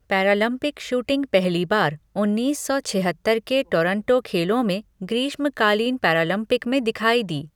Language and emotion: Hindi, neutral